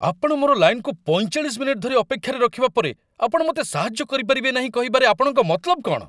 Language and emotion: Odia, angry